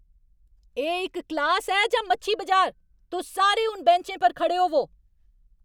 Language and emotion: Dogri, angry